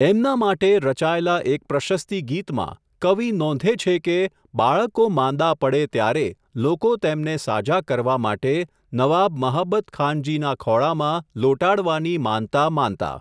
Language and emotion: Gujarati, neutral